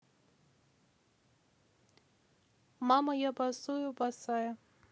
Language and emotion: Russian, neutral